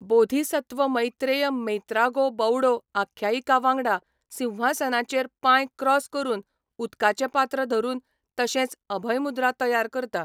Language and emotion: Goan Konkani, neutral